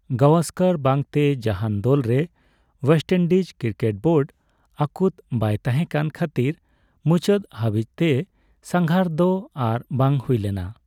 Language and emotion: Santali, neutral